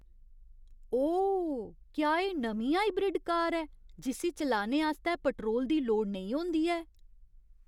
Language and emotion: Dogri, surprised